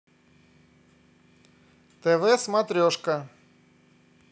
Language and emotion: Russian, positive